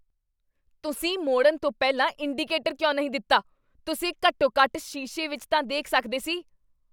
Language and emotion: Punjabi, angry